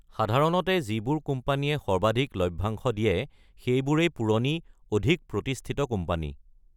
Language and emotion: Assamese, neutral